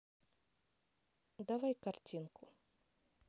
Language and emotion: Russian, neutral